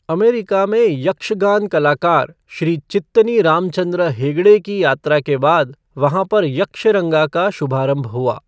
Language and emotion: Hindi, neutral